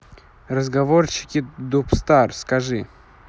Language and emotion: Russian, neutral